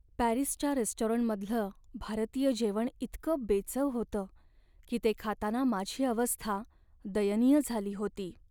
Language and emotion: Marathi, sad